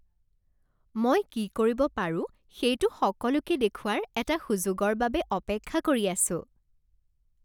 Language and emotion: Assamese, happy